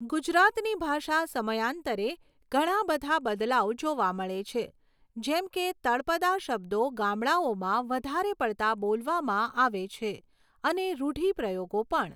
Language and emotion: Gujarati, neutral